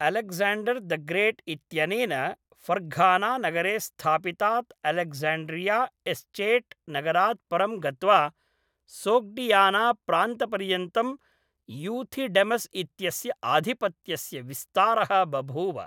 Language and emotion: Sanskrit, neutral